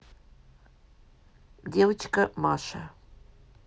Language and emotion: Russian, neutral